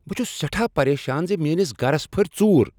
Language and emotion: Kashmiri, angry